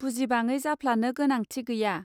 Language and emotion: Bodo, neutral